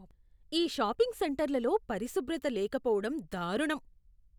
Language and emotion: Telugu, disgusted